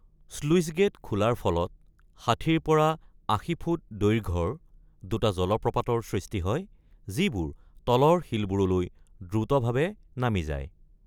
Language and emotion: Assamese, neutral